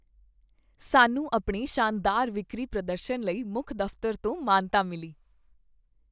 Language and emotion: Punjabi, happy